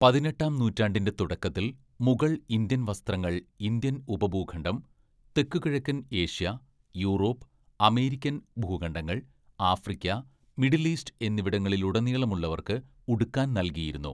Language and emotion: Malayalam, neutral